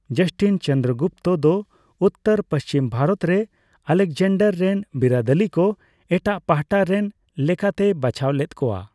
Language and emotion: Santali, neutral